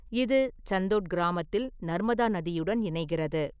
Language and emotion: Tamil, neutral